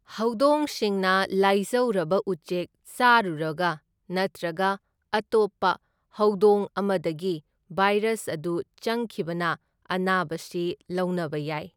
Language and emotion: Manipuri, neutral